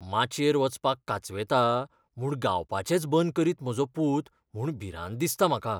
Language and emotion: Goan Konkani, fearful